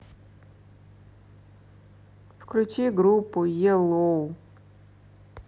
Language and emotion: Russian, neutral